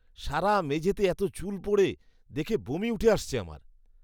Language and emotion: Bengali, disgusted